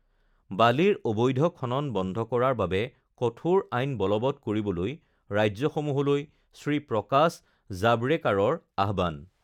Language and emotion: Assamese, neutral